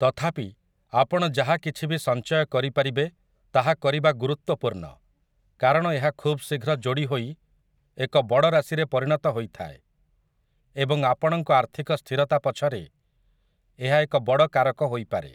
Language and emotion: Odia, neutral